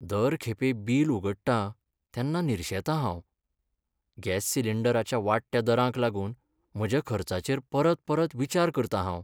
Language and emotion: Goan Konkani, sad